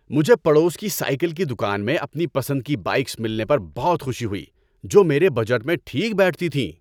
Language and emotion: Urdu, happy